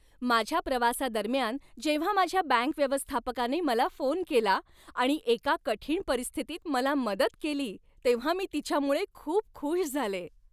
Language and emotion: Marathi, happy